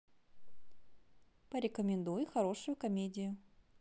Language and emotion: Russian, positive